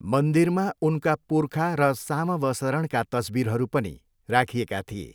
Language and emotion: Nepali, neutral